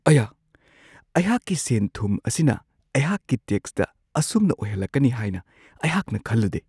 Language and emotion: Manipuri, surprised